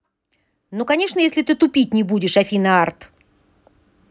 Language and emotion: Russian, angry